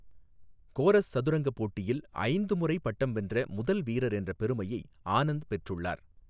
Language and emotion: Tamil, neutral